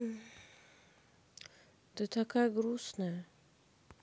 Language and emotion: Russian, sad